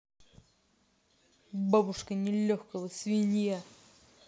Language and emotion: Russian, angry